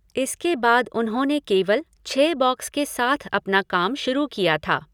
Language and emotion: Hindi, neutral